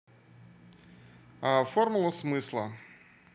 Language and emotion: Russian, neutral